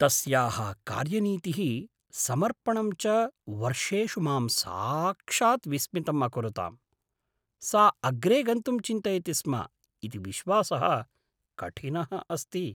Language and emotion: Sanskrit, surprised